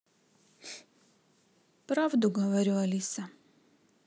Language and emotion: Russian, sad